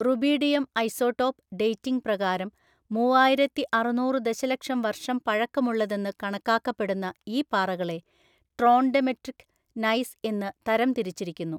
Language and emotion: Malayalam, neutral